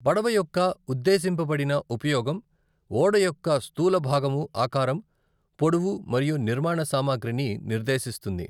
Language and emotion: Telugu, neutral